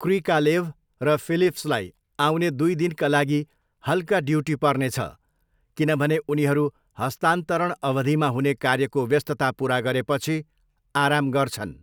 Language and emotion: Nepali, neutral